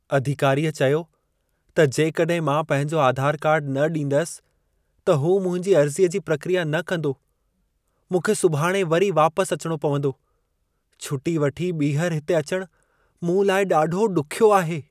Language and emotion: Sindhi, sad